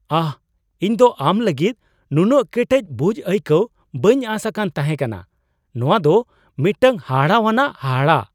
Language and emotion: Santali, surprised